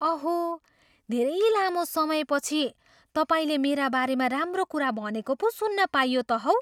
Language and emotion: Nepali, surprised